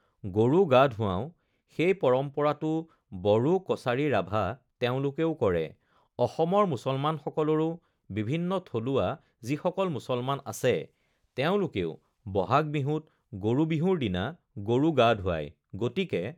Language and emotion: Assamese, neutral